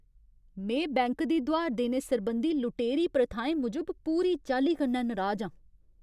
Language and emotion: Dogri, angry